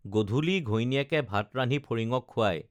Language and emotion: Assamese, neutral